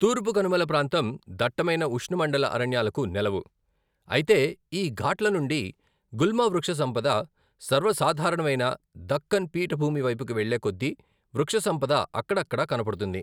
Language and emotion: Telugu, neutral